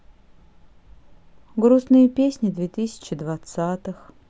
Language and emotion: Russian, sad